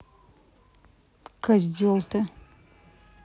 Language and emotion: Russian, angry